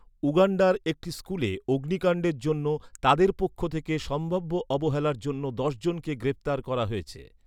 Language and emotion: Bengali, neutral